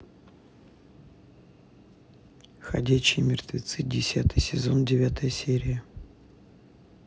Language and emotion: Russian, neutral